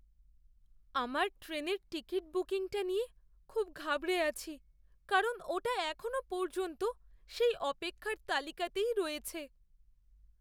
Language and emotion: Bengali, fearful